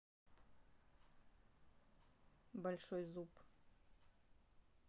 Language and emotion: Russian, neutral